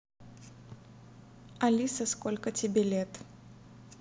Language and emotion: Russian, neutral